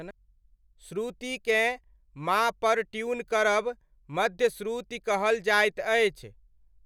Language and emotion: Maithili, neutral